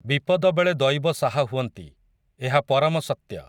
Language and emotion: Odia, neutral